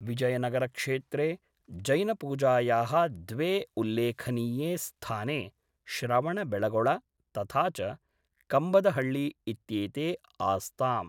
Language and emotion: Sanskrit, neutral